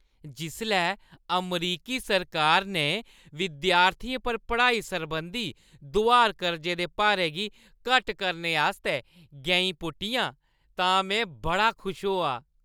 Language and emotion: Dogri, happy